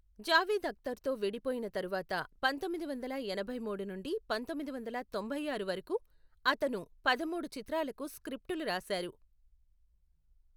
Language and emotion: Telugu, neutral